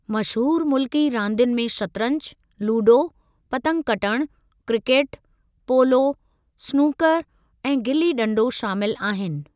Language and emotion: Sindhi, neutral